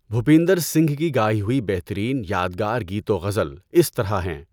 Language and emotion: Urdu, neutral